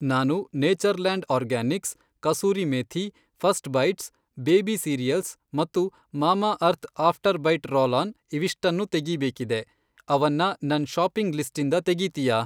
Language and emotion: Kannada, neutral